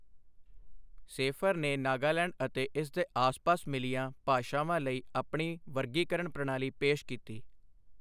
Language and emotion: Punjabi, neutral